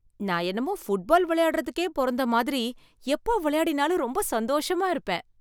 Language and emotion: Tamil, happy